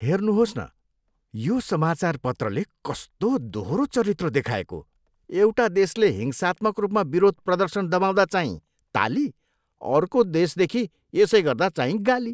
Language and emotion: Nepali, disgusted